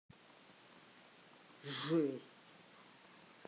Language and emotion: Russian, angry